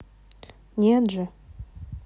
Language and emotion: Russian, neutral